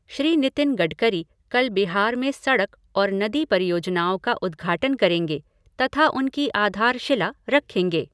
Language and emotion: Hindi, neutral